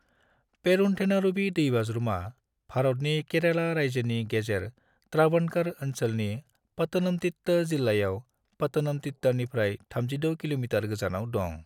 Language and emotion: Bodo, neutral